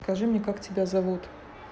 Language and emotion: Russian, neutral